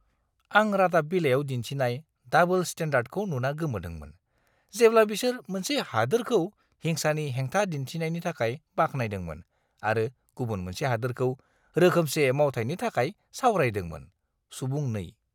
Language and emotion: Bodo, disgusted